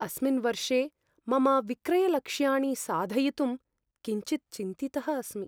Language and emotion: Sanskrit, fearful